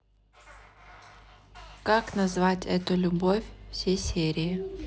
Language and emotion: Russian, neutral